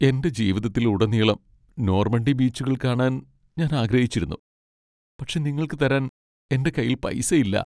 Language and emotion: Malayalam, sad